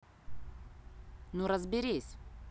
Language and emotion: Russian, neutral